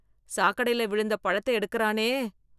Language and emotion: Tamil, disgusted